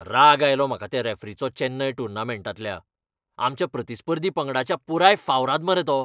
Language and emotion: Goan Konkani, angry